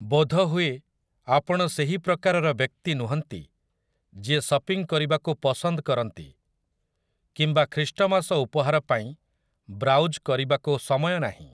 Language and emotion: Odia, neutral